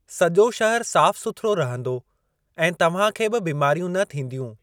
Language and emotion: Sindhi, neutral